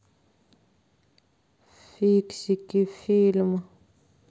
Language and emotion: Russian, sad